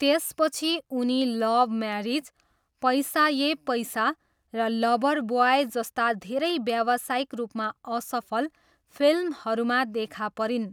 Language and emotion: Nepali, neutral